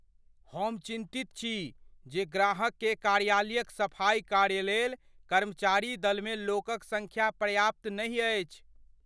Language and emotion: Maithili, fearful